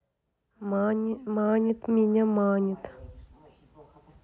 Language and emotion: Russian, neutral